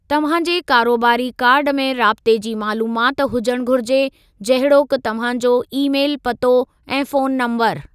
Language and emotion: Sindhi, neutral